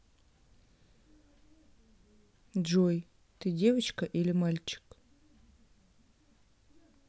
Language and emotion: Russian, neutral